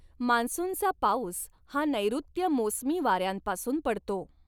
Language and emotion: Marathi, neutral